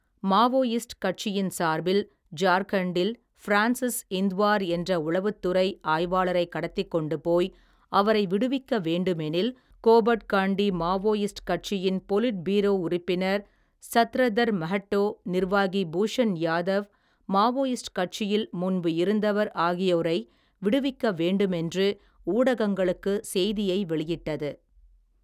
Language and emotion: Tamil, neutral